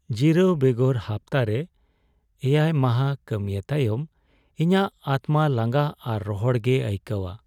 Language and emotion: Santali, sad